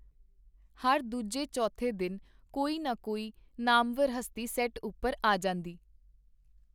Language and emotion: Punjabi, neutral